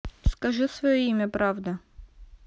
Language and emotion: Russian, neutral